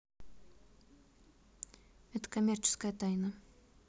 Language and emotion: Russian, neutral